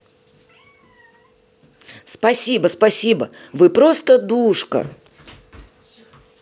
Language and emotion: Russian, neutral